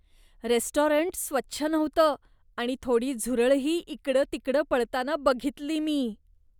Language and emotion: Marathi, disgusted